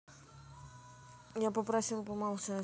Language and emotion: Russian, neutral